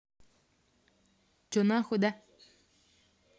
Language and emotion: Russian, angry